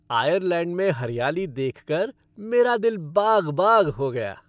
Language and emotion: Hindi, happy